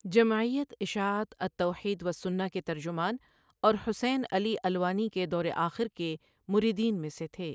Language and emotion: Urdu, neutral